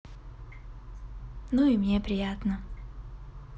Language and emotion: Russian, positive